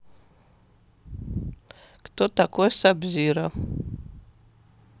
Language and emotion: Russian, neutral